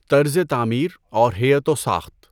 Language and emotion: Urdu, neutral